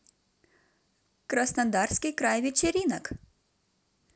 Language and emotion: Russian, positive